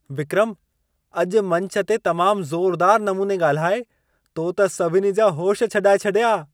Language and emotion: Sindhi, surprised